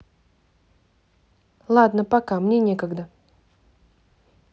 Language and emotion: Russian, neutral